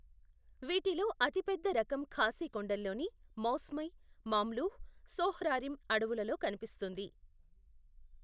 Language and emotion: Telugu, neutral